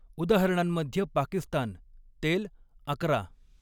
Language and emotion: Marathi, neutral